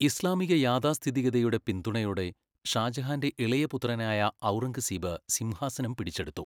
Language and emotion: Malayalam, neutral